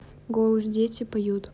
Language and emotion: Russian, neutral